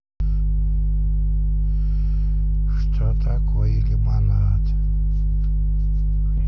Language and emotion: Russian, neutral